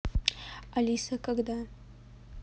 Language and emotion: Russian, neutral